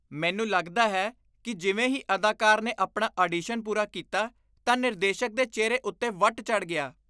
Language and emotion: Punjabi, disgusted